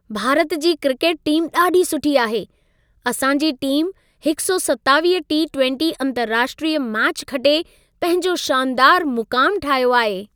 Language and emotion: Sindhi, happy